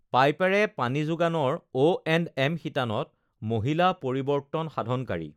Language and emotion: Assamese, neutral